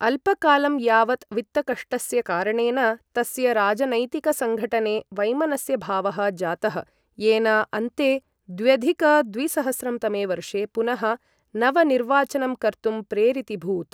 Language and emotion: Sanskrit, neutral